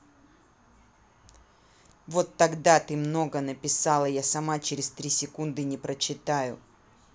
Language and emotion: Russian, angry